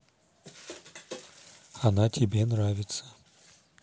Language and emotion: Russian, neutral